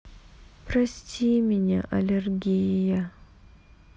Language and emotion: Russian, sad